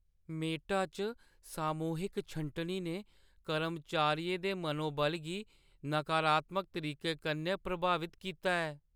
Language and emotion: Dogri, sad